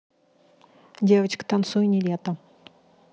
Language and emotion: Russian, neutral